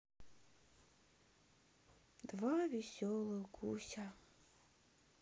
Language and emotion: Russian, sad